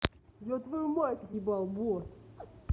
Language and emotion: Russian, angry